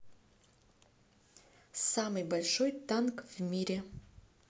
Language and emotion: Russian, neutral